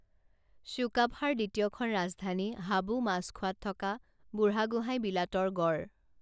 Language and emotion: Assamese, neutral